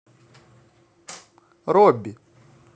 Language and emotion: Russian, neutral